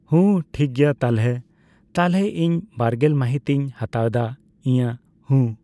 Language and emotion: Santali, neutral